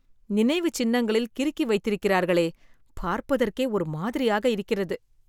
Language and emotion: Tamil, disgusted